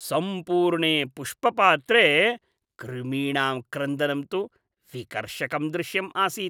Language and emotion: Sanskrit, disgusted